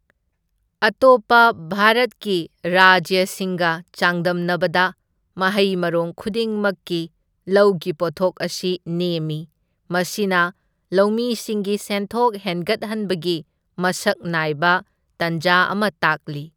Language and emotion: Manipuri, neutral